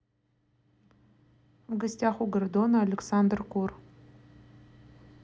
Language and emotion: Russian, neutral